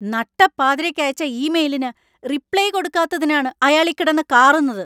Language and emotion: Malayalam, angry